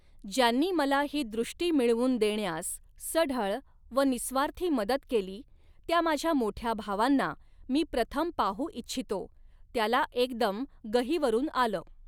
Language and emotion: Marathi, neutral